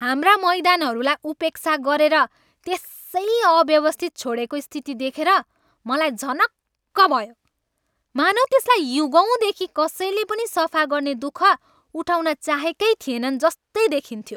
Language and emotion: Nepali, angry